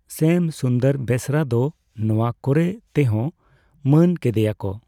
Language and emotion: Santali, neutral